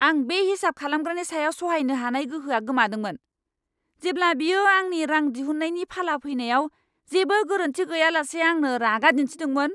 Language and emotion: Bodo, angry